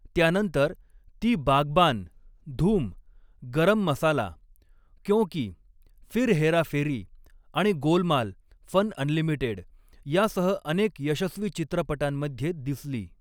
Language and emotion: Marathi, neutral